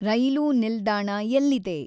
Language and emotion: Kannada, neutral